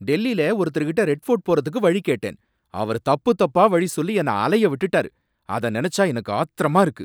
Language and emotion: Tamil, angry